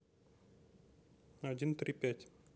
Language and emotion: Russian, neutral